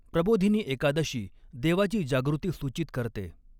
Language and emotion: Marathi, neutral